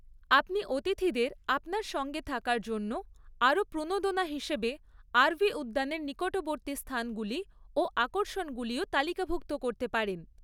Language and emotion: Bengali, neutral